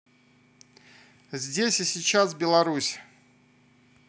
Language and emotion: Russian, neutral